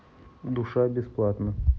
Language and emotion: Russian, neutral